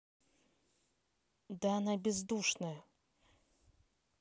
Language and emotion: Russian, angry